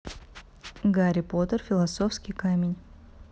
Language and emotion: Russian, neutral